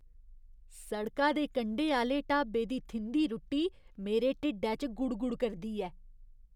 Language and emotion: Dogri, disgusted